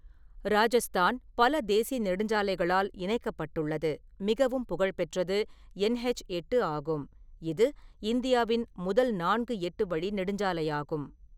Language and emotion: Tamil, neutral